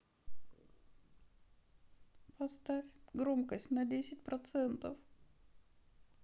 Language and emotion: Russian, sad